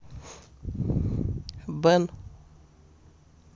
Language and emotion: Russian, neutral